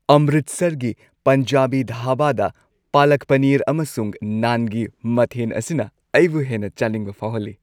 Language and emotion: Manipuri, happy